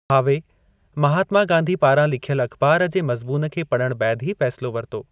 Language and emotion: Sindhi, neutral